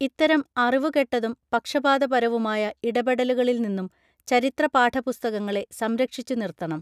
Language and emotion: Malayalam, neutral